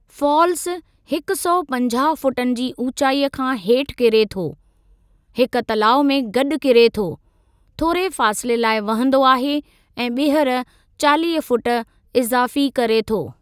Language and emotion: Sindhi, neutral